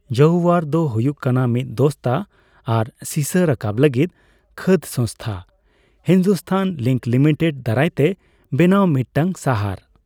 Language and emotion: Santali, neutral